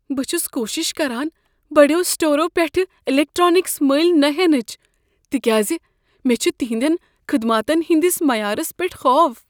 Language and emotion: Kashmiri, fearful